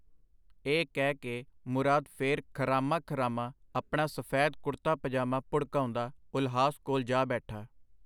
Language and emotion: Punjabi, neutral